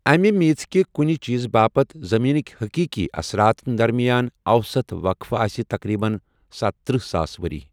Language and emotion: Kashmiri, neutral